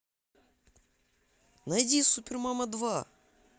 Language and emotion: Russian, positive